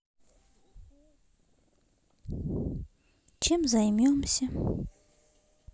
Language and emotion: Russian, neutral